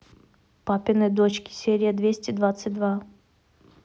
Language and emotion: Russian, neutral